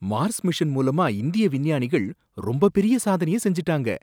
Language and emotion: Tamil, surprised